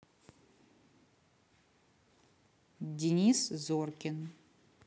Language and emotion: Russian, neutral